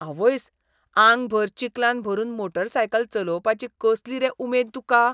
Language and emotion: Goan Konkani, disgusted